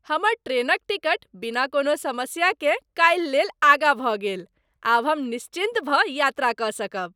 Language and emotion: Maithili, happy